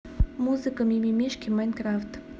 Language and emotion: Russian, neutral